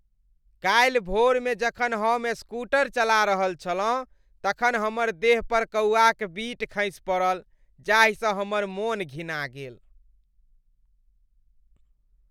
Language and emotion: Maithili, disgusted